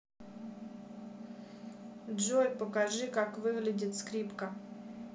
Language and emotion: Russian, neutral